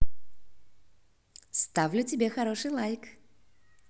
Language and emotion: Russian, positive